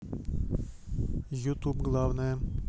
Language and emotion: Russian, neutral